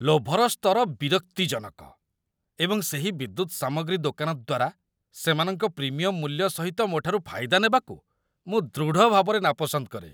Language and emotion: Odia, disgusted